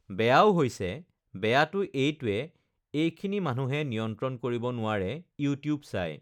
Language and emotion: Assamese, neutral